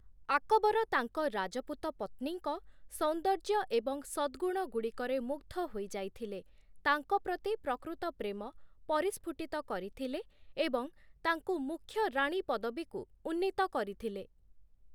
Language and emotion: Odia, neutral